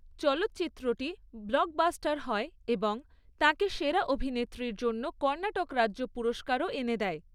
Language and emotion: Bengali, neutral